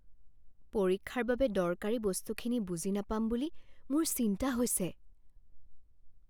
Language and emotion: Assamese, fearful